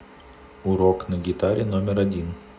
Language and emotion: Russian, neutral